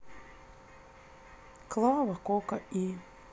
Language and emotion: Russian, neutral